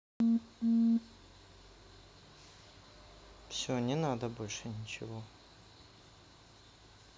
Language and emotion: Russian, sad